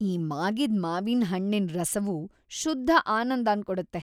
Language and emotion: Kannada, happy